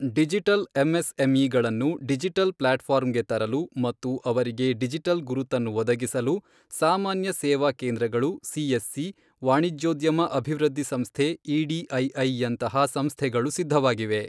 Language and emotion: Kannada, neutral